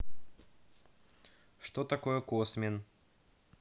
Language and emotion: Russian, neutral